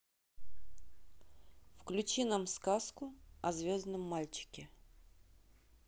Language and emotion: Russian, neutral